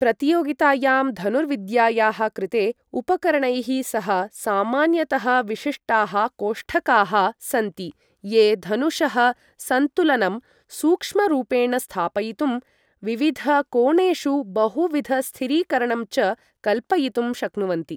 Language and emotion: Sanskrit, neutral